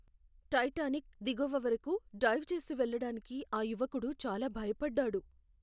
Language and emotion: Telugu, fearful